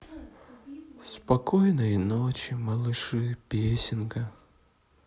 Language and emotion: Russian, sad